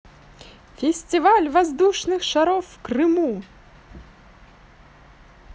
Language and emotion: Russian, positive